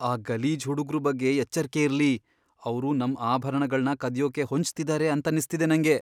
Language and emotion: Kannada, fearful